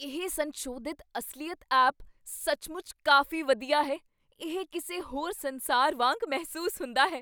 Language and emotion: Punjabi, surprised